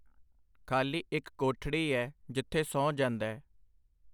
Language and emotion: Punjabi, neutral